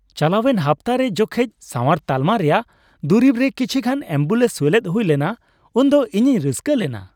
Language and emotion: Santali, happy